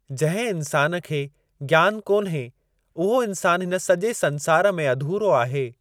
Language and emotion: Sindhi, neutral